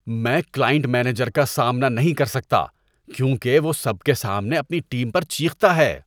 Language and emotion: Urdu, disgusted